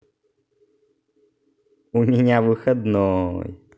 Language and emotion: Russian, positive